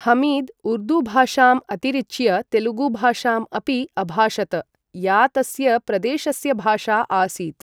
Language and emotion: Sanskrit, neutral